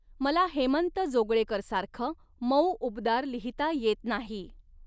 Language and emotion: Marathi, neutral